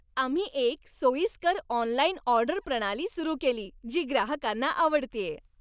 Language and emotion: Marathi, happy